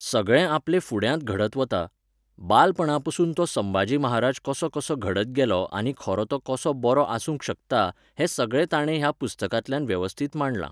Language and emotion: Goan Konkani, neutral